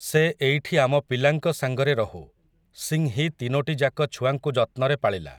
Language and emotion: Odia, neutral